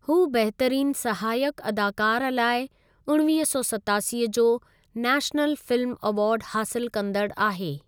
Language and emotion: Sindhi, neutral